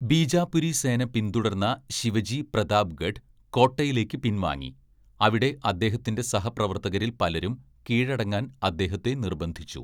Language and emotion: Malayalam, neutral